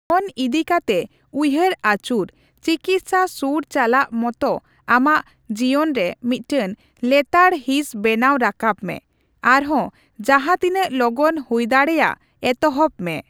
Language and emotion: Santali, neutral